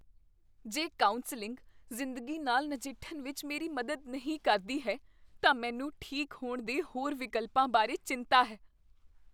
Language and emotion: Punjabi, fearful